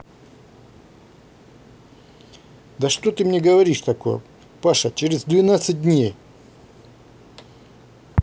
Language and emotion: Russian, angry